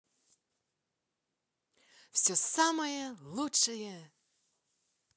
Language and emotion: Russian, positive